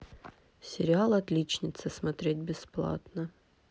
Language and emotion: Russian, neutral